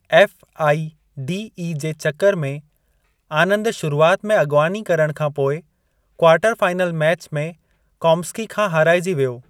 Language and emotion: Sindhi, neutral